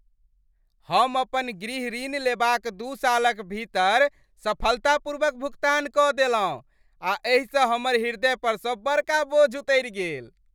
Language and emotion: Maithili, happy